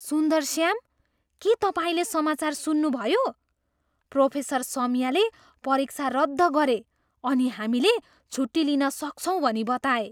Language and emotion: Nepali, surprised